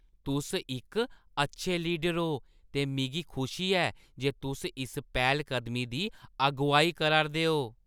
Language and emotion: Dogri, happy